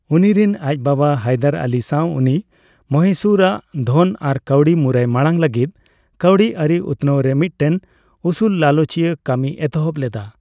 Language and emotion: Santali, neutral